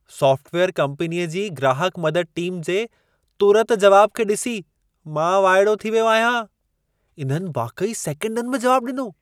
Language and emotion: Sindhi, surprised